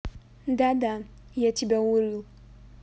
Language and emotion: Russian, neutral